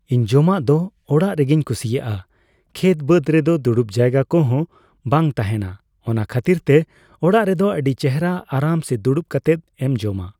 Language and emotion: Santali, neutral